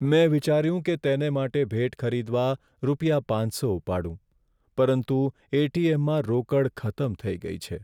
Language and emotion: Gujarati, sad